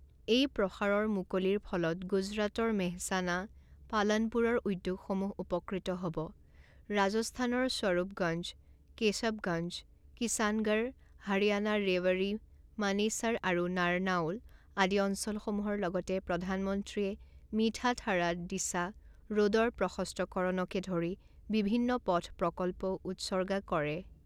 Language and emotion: Assamese, neutral